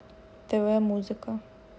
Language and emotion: Russian, neutral